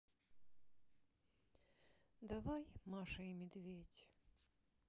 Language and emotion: Russian, sad